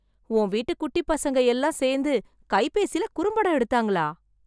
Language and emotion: Tamil, surprised